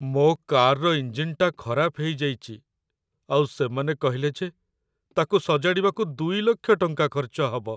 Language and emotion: Odia, sad